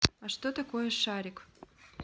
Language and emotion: Russian, neutral